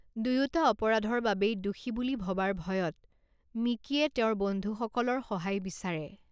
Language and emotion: Assamese, neutral